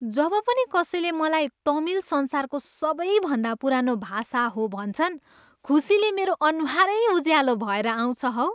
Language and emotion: Nepali, happy